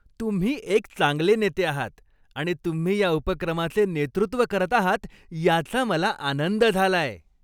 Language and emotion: Marathi, happy